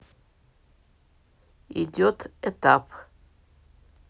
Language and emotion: Russian, neutral